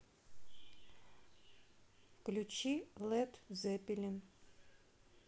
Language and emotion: Russian, neutral